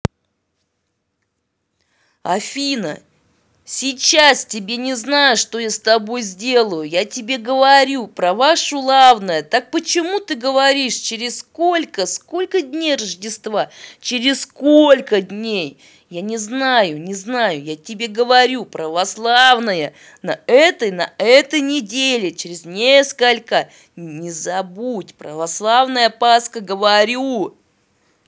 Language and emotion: Russian, angry